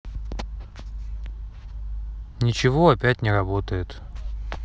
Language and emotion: Russian, sad